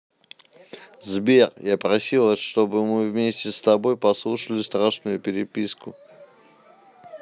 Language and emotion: Russian, neutral